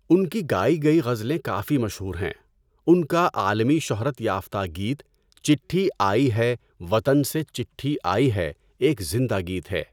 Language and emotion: Urdu, neutral